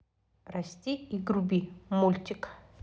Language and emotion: Russian, neutral